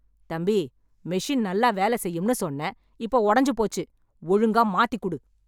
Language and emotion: Tamil, angry